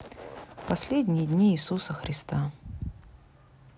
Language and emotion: Russian, sad